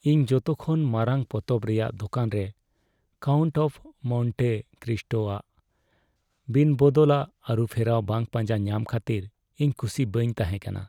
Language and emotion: Santali, sad